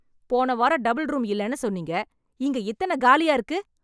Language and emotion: Tamil, angry